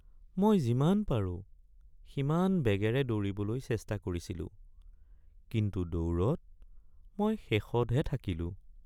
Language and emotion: Assamese, sad